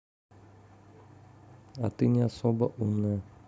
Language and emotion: Russian, neutral